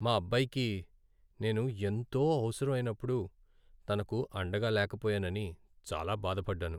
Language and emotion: Telugu, sad